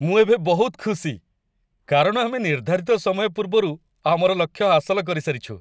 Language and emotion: Odia, happy